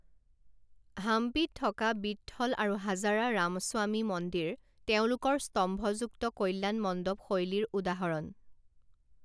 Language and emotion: Assamese, neutral